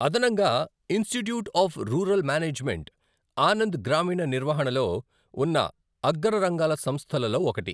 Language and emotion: Telugu, neutral